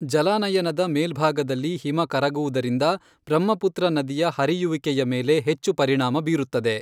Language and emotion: Kannada, neutral